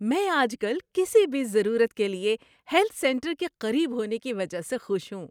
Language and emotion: Urdu, happy